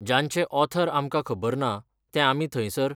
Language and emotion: Goan Konkani, neutral